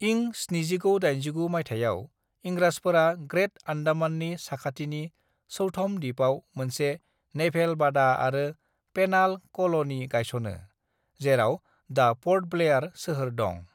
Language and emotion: Bodo, neutral